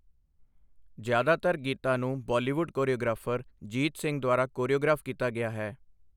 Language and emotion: Punjabi, neutral